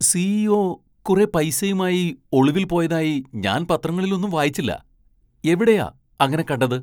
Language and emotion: Malayalam, surprised